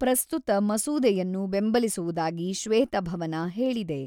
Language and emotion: Kannada, neutral